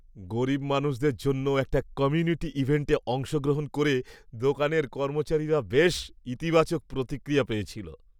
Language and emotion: Bengali, happy